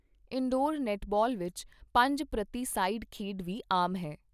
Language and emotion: Punjabi, neutral